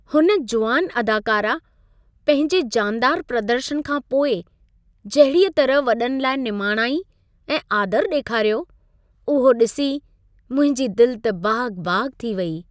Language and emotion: Sindhi, happy